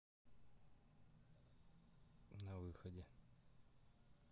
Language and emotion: Russian, neutral